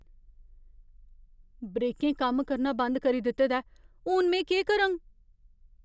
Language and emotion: Dogri, fearful